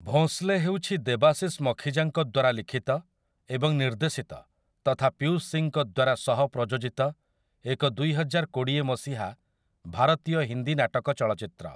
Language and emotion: Odia, neutral